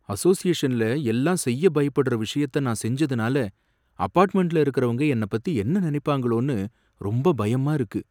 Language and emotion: Tamil, fearful